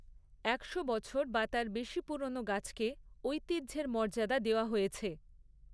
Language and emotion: Bengali, neutral